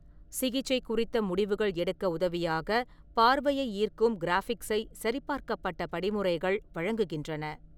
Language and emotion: Tamil, neutral